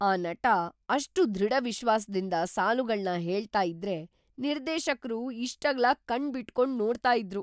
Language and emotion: Kannada, surprised